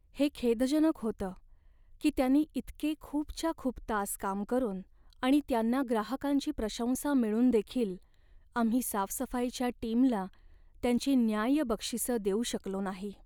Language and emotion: Marathi, sad